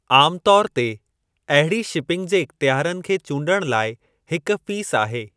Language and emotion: Sindhi, neutral